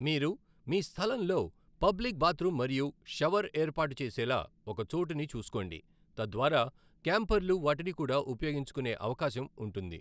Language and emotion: Telugu, neutral